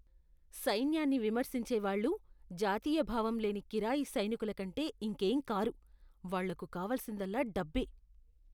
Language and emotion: Telugu, disgusted